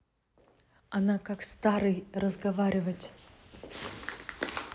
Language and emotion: Russian, angry